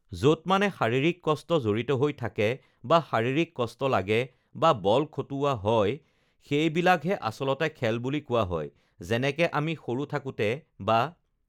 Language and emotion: Assamese, neutral